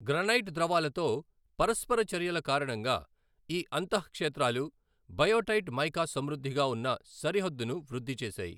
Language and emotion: Telugu, neutral